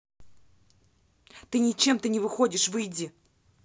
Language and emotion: Russian, angry